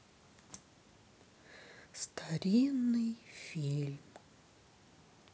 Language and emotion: Russian, sad